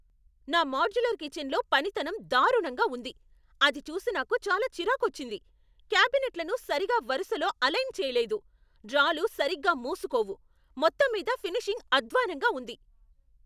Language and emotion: Telugu, angry